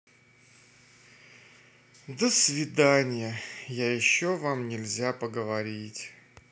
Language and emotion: Russian, sad